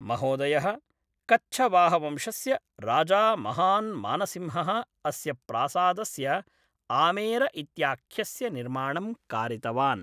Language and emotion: Sanskrit, neutral